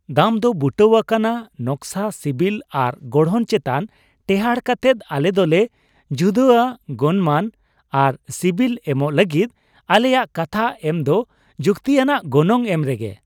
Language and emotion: Santali, happy